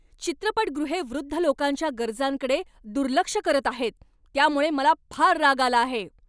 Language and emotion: Marathi, angry